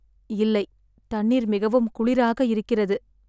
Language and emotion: Tamil, sad